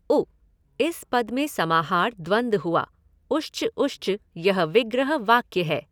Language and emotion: Hindi, neutral